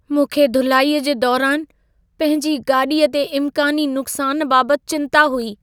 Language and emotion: Sindhi, fearful